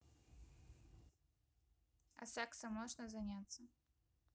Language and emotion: Russian, neutral